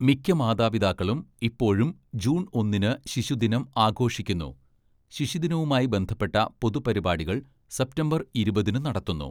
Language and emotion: Malayalam, neutral